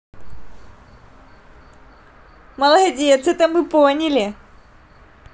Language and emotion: Russian, positive